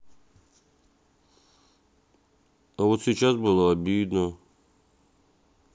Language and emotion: Russian, sad